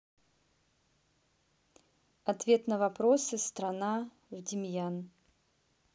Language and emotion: Russian, neutral